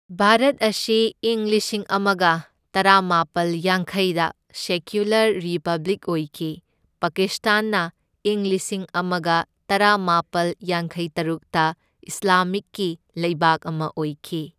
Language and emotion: Manipuri, neutral